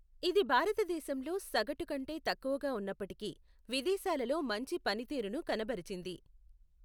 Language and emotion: Telugu, neutral